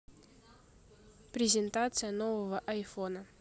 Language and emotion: Russian, neutral